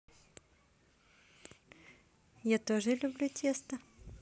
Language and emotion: Russian, positive